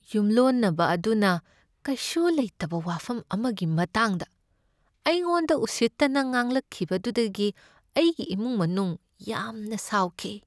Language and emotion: Manipuri, sad